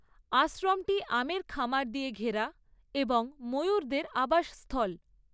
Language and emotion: Bengali, neutral